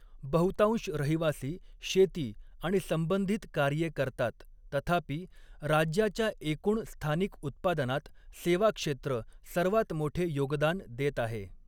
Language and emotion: Marathi, neutral